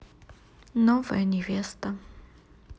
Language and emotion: Russian, neutral